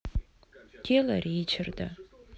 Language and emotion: Russian, sad